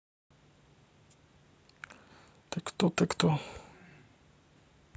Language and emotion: Russian, neutral